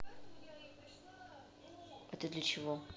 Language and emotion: Russian, neutral